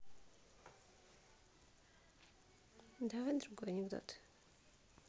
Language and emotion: Russian, neutral